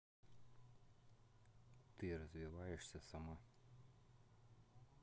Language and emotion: Russian, neutral